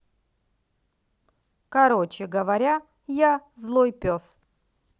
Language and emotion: Russian, neutral